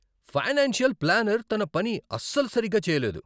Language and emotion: Telugu, angry